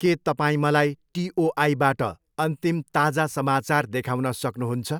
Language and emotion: Nepali, neutral